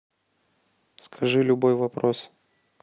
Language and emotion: Russian, neutral